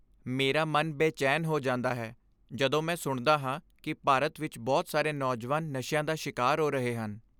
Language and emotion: Punjabi, sad